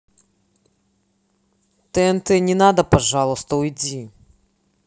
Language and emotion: Russian, angry